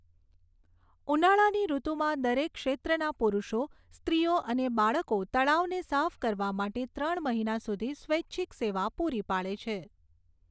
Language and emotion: Gujarati, neutral